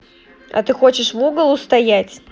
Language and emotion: Russian, angry